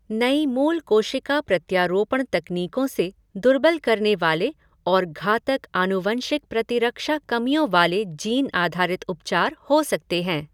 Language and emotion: Hindi, neutral